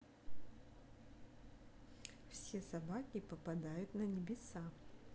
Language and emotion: Russian, positive